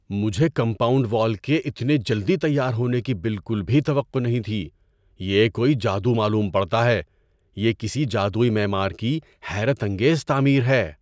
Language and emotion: Urdu, surprised